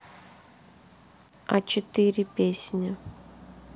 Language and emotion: Russian, sad